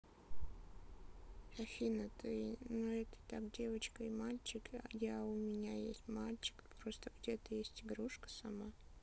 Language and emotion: Russian, neutral